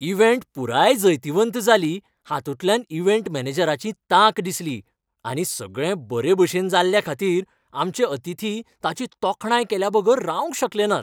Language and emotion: Goan Konkani, happy